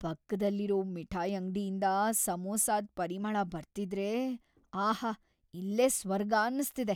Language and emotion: Kannada, happy